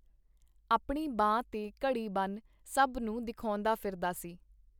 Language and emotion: Punjabi, neutral